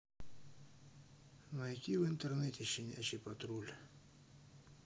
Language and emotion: Russian, neutral